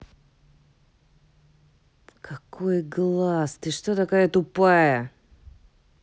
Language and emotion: Russian, angry